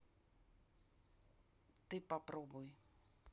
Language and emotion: Russian, neutral